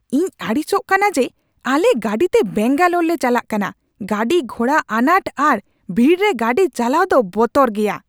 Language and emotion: Santali, angry